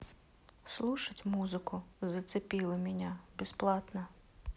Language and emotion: Russian, neutral